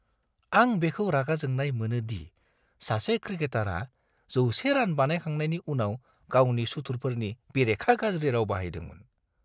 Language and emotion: Bodo, disgusted